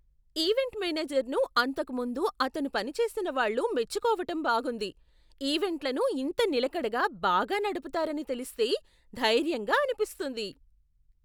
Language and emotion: Telugu, surprised